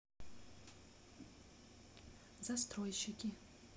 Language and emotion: Russian, neutral